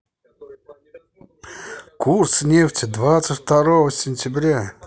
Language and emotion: Russian, positive